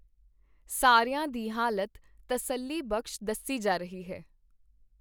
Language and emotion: Punjabi, neutral